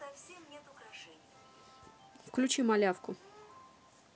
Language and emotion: Russian, neutral